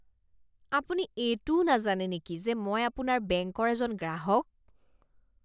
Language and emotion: Assamese, disgusted